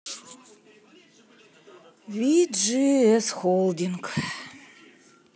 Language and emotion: Russian, sad